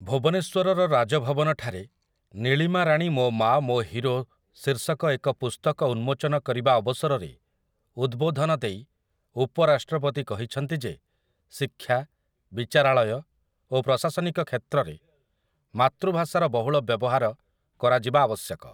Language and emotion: Odia, neutral